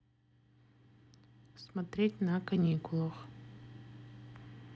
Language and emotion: Russian, neutral